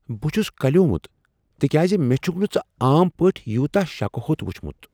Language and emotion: Kashmiri, surprised